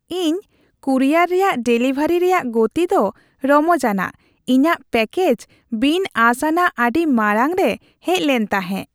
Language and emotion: Santali, happy